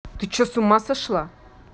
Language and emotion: Russian, angry